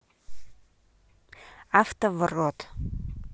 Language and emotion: Russian, neutral